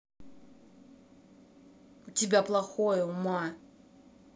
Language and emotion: Russian, angry